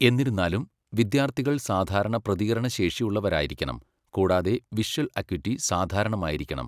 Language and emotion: Malayalam, neutral